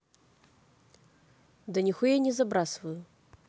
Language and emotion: Russian, neutral